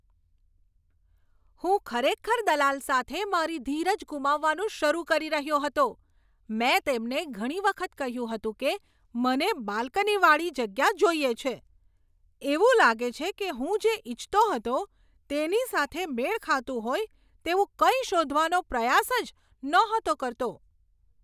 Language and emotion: Gujarati, angry